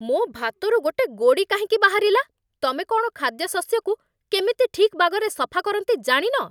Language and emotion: Odia, angry